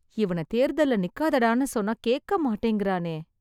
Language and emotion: Tamil, sad